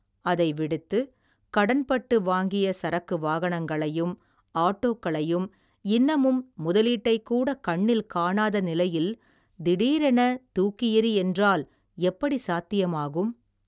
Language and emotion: Tamil, neutral